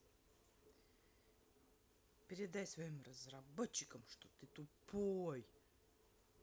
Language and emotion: Russian, angry